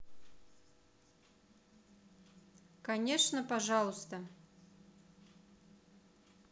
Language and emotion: Russian, neutral